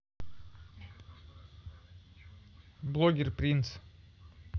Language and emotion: Russian, neutral